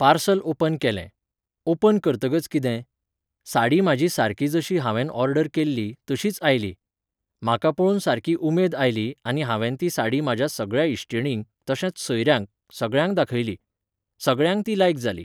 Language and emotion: Goan Konkani, neutral